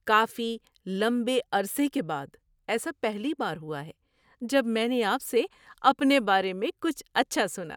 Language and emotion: Urdu, surprised